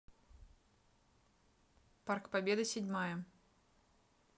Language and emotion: Russian, neutral